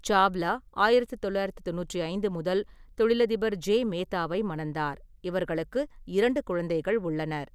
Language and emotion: Tamil, neutral